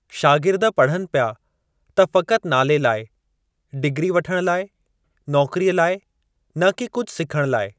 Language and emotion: Sindhi, neutral